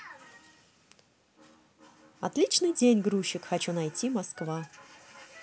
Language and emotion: Russian, positive